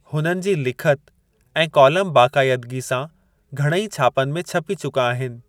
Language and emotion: Sindhi, neutral